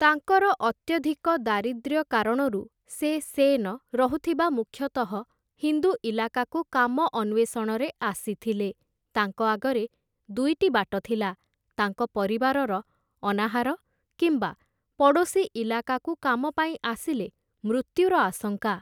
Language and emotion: Odia, neutral